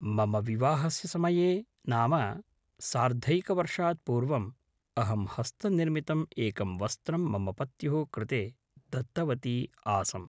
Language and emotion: Sanskrit, neutral